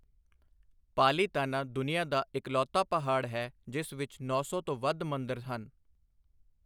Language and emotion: Punjabi, neutral